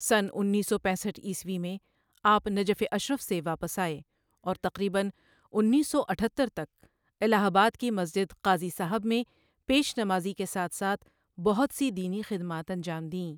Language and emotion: Urdu, neutral